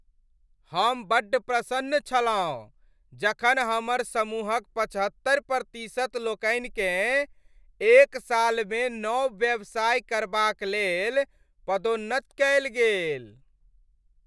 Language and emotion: Maithili, happy